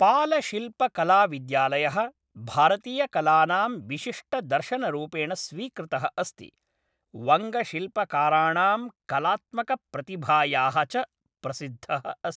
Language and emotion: Sanskrit, neutral